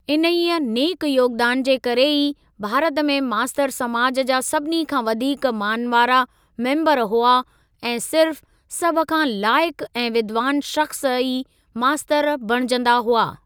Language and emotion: Sindhi, neutral